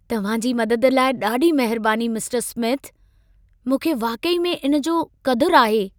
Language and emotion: Sindhi, happy